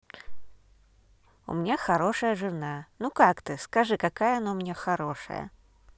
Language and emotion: Russian, positive